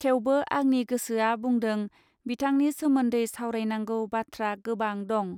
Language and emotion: Bodo, neutral